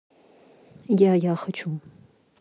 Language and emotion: Russian, neutral